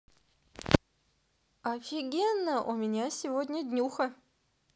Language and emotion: Russian, positive